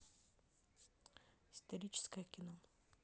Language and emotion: Russian, neutral